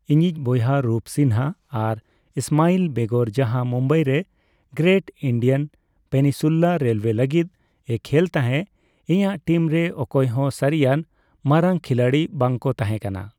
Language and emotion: Santali, neutral